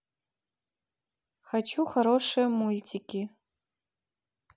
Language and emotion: Russian, neutral